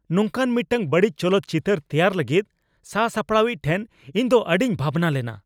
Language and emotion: Santali, angry